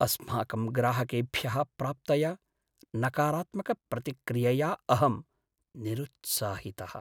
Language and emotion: Sanskrit, sad